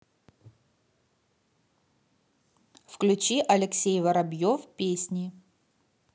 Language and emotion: Russian, neutral